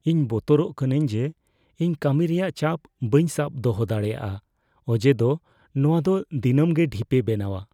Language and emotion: Santali, fearful